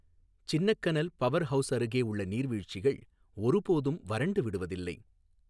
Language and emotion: Tamil, neutral